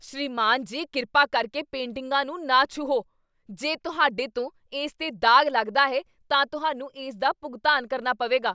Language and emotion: Punjabi, angry